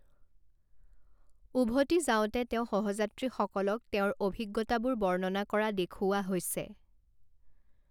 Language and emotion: Assamese, neutral